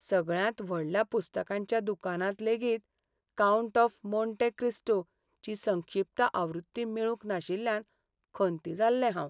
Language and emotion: Goan Konkani, sad